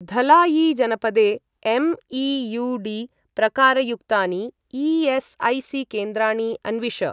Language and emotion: Sanskrit, neutral